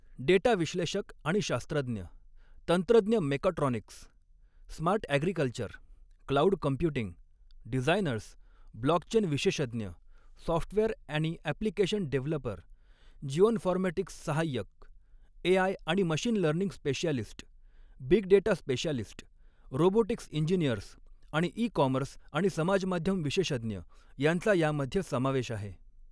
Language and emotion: Marathi, neutral